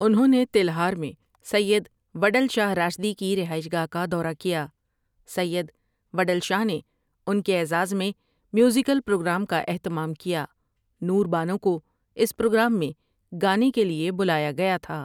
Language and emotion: Urdu, neutral